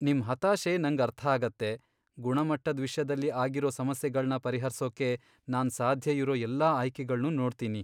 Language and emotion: Kannada, sad